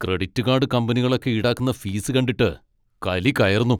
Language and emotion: Malayalam, angry